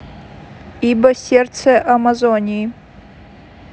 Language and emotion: Russian, neutral